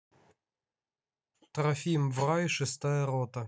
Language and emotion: Russian, neutral